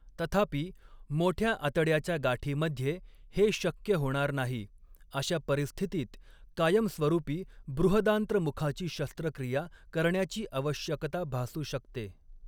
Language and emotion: Marathi, neutral